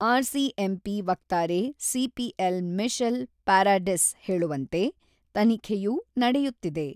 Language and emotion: Kannada, neutral